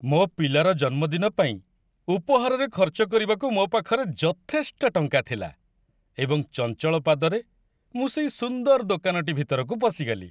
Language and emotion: Odia, happy